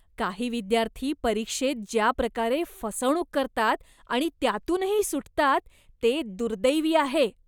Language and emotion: Marathi, disgusted